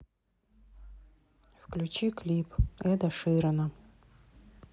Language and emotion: Russian, neutral